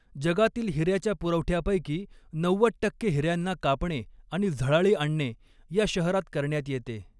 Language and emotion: Marathi, neutral